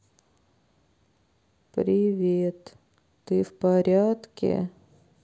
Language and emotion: Russian, sad